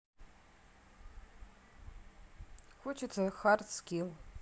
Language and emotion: Russian, neutral